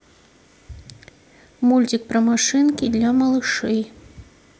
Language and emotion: Russian, neutral